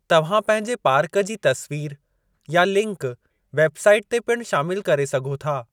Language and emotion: Sindhi, neutral